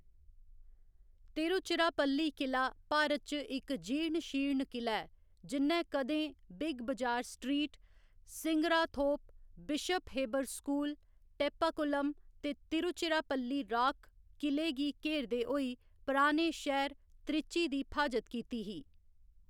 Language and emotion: Dogri, neutral